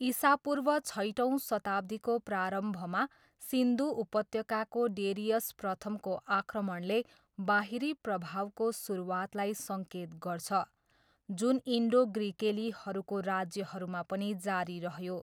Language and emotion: Nepali, neutral